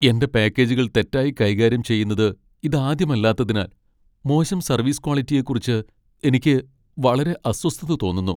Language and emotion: Malayalam, sad